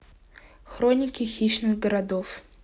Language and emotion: Russian, neutral